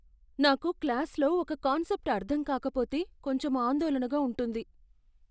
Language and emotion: Telugu, fearful